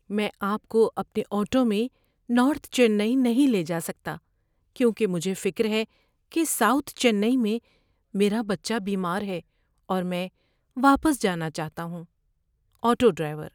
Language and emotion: Urdu, sad